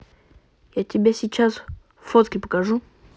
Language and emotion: Russian, neutral